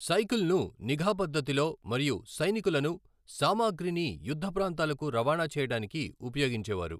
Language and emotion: Telugu, neutral